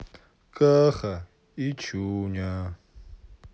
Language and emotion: Russian, sad